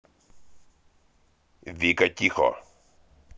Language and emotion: Russian, angry